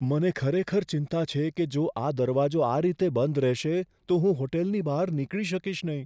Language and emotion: Gujarati, fearful